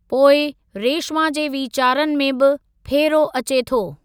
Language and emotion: Sindhi, neutral